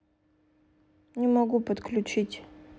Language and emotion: Russian, sad